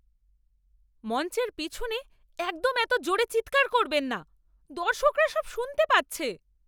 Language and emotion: Bengali, angry